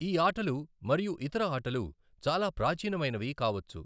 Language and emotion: Telugu, neutral